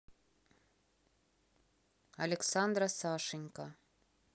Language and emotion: Russian, neutral